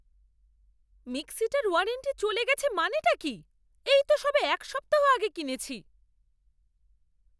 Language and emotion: Bengali, angry